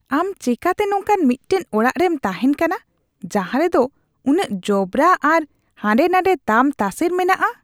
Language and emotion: Santali, disgusted